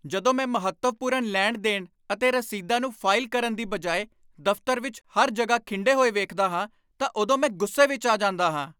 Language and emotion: Punjabi, angry